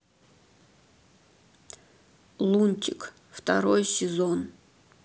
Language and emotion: Russian, neutral